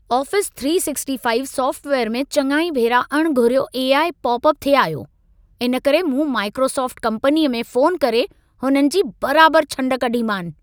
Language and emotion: Sindhi, angry